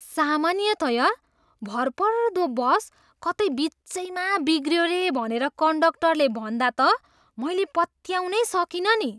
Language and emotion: Nepali, surprised